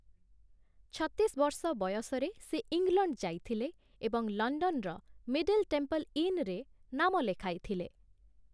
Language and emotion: Odia, neutral